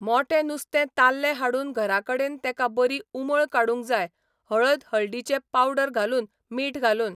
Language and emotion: Goan Konkani, neutral